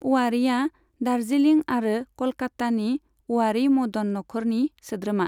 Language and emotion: Bodo, neutral